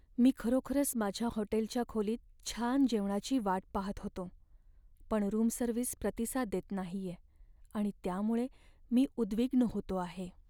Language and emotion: Marathi, sad